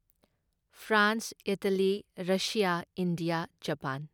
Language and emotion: Manipuri, neutral